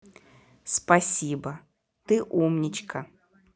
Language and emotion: Russian, positive